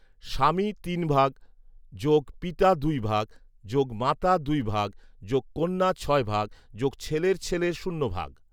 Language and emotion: Bengali, neutral